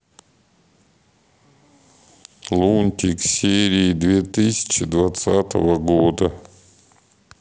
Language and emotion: Russian, sad